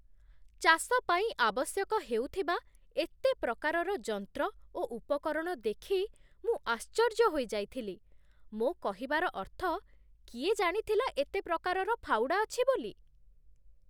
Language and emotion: Odia, surprised